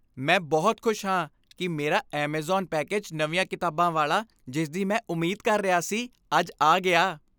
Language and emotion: Punjabi, happy